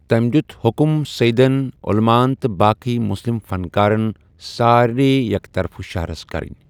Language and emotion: Kashmiri, neutral